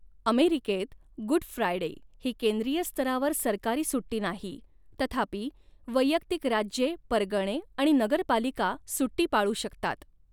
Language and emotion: Marathi, neutral